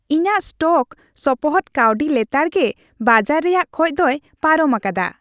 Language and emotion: Santali, happy